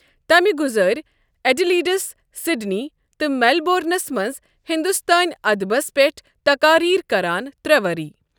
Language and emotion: Kashmiri, neutral